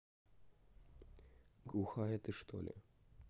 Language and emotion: Russian, neutral